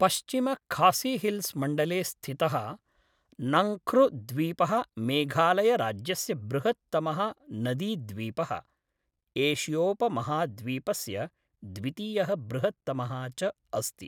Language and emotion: Sanskrit, neutral